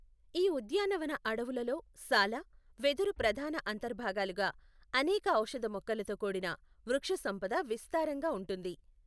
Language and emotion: Telugu, neutral